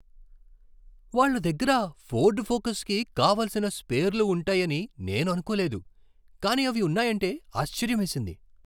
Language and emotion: Telugu, surprised